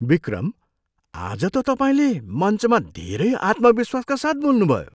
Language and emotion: Nepali, surprised